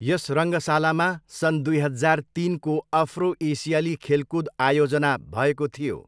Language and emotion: Nepali, neutral